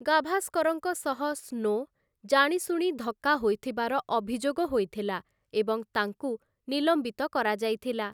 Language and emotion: Odia, neutral